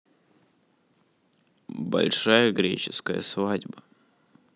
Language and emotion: Russian, neutral